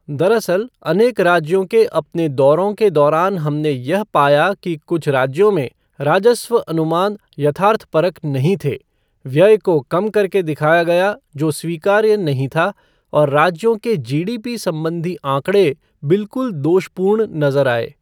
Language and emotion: Hindi, neutral